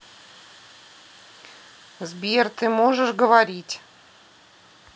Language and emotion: Russian, neutral